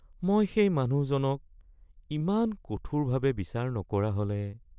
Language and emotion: Assamese, sad